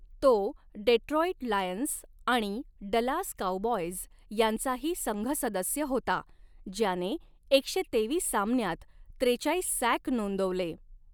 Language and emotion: Marathi, neutral